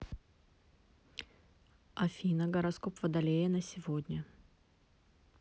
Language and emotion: Russian, neutral